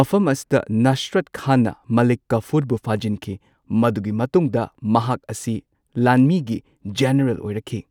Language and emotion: Manipuri, neutral